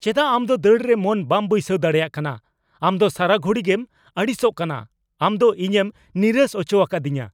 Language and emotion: Santali, angry